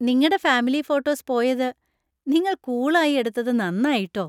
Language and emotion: Malayalam, happy